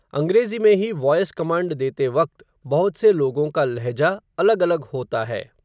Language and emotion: Hindi, neutral